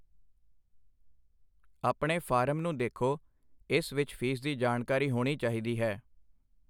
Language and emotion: Punjabi, neutral